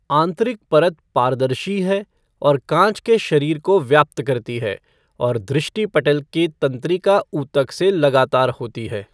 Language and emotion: Hindi, neutral